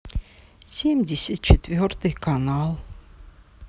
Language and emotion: Russian, sad